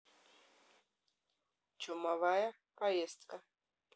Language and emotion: Russian, neutral